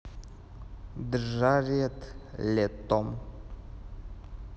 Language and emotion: Russian, neutral